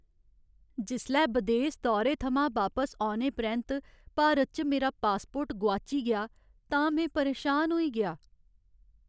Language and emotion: Dogri, sad